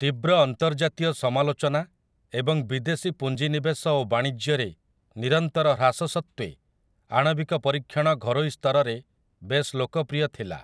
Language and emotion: Odia, neutral